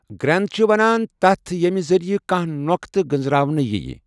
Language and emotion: Kashmiri, neutral